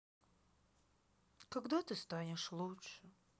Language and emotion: Russian, sad